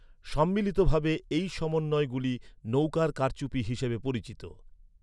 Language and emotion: Bengali, neutral